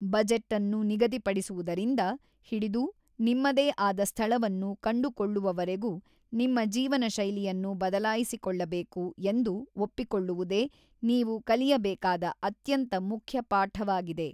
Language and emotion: Kannada, neutral